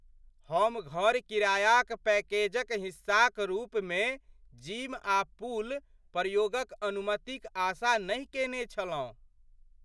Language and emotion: Maithili, surprised